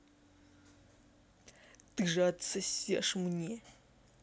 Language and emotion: Russian, angry